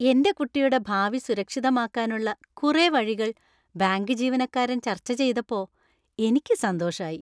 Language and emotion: Malayalam, happy